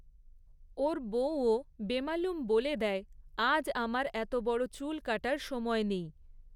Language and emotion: Bengali, neutral